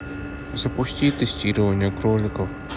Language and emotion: Russian, neutral